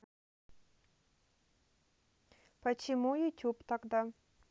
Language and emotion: Russian, neutral